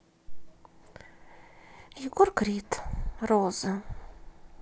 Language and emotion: Russian, sad